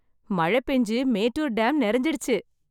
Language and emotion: Tamil, happy